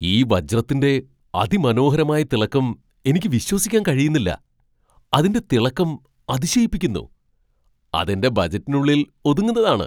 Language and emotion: Malayalam, surprised